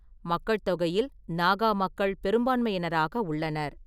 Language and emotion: Tamil, neutral